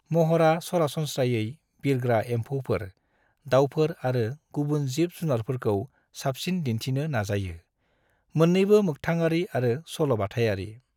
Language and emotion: Bodo, neutral